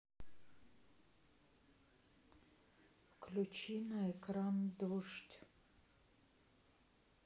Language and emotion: Russian, sad